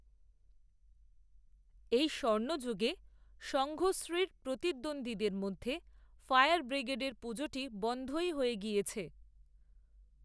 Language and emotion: Bengali, neutral